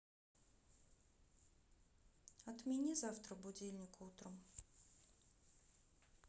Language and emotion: Russian, neutral